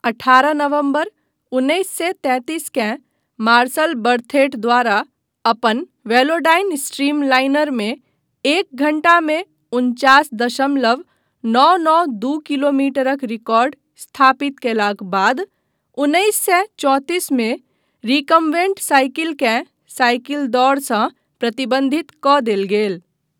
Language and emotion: Maithili, neutral